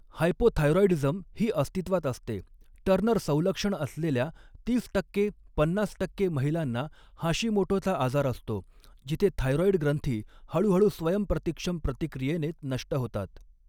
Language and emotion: Marathi, neutral